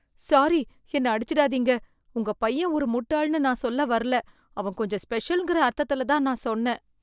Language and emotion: Tamil, fearful